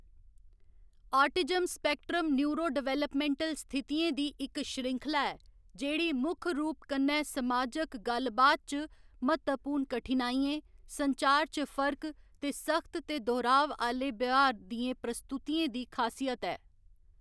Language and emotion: Dogri, neutral